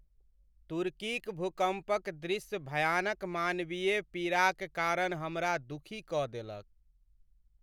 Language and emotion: Maithili, sad